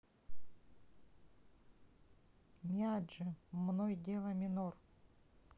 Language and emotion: Russian, neutral